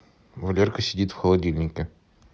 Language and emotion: Russian, neutral